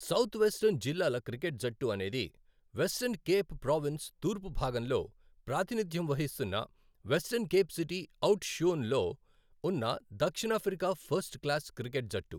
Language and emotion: Telugu, neutral